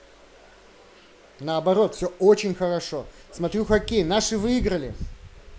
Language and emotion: Russian, positive